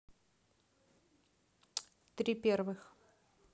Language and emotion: Russian, neutral